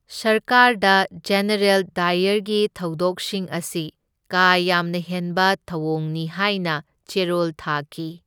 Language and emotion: Manipuri, neutral